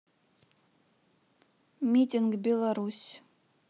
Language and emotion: Russian, neutral